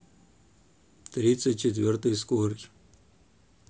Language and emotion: Russian, neutral